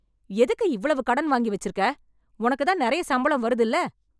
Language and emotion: Tamil, angry